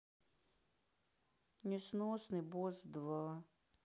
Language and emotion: Russian, sad